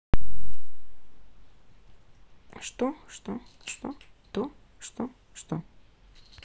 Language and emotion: Russian, neutral